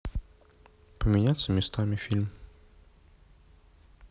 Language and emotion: Russian, neutral